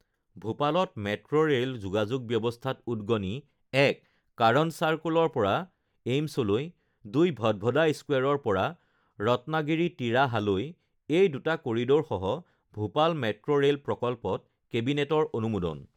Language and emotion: Assamese, neutral